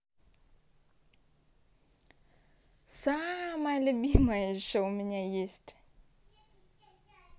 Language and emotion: Russian, positive